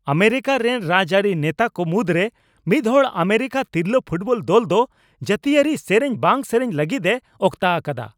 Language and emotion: Santali, angry